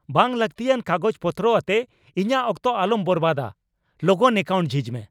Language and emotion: Santali, angry